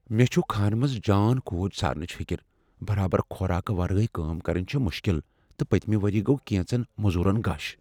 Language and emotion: Kashmiri, fearful